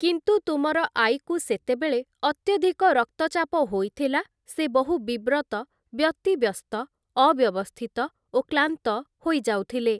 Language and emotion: Odia, neutral